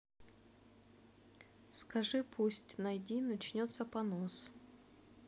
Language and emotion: Russian, neutral